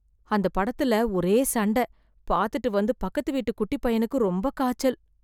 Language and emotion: Tamil, fearful